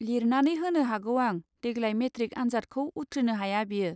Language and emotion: Bodo, neutral